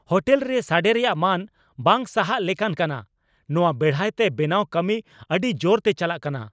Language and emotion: Santali, angry